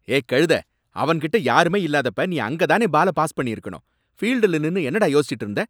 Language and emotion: Tamil, angry